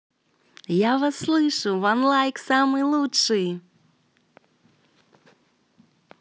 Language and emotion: Russian, positive